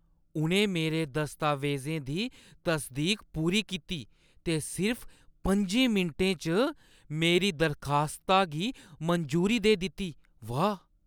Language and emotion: Dogri, surprised